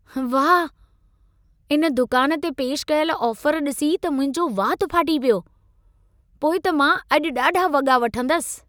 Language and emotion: Sindhi, surprised